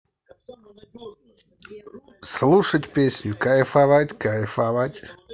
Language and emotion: Russian, positive